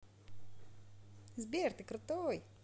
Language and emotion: Russian, positive